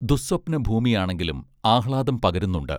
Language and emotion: Malayalam, neutral